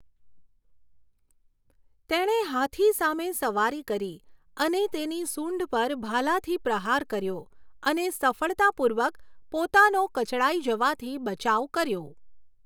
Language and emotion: Gujarati, neutral